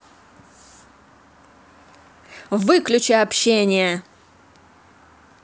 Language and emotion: Russian, angry